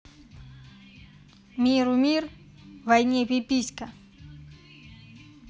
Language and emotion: Russian, neutral